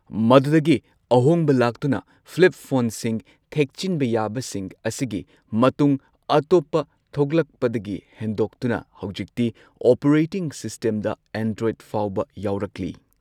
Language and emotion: Manipuri, neutral